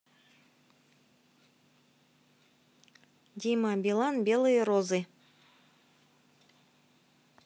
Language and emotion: Russian, neutral